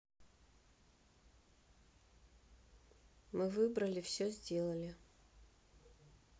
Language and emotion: Russian, neutral